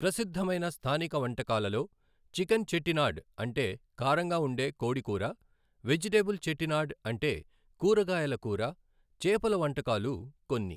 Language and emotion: Telugu, neutral